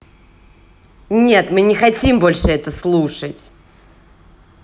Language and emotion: Russian, angry